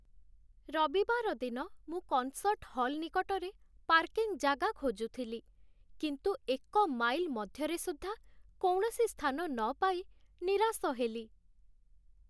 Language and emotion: Odia, sad